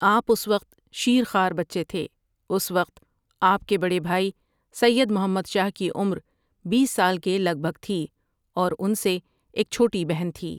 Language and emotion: Urdu, neutral